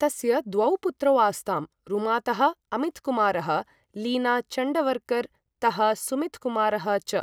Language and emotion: Sanskrit, neutral